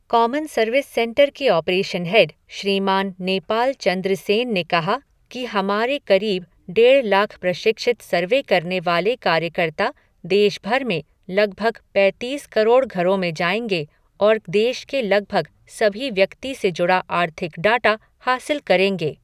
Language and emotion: Hindi, neutral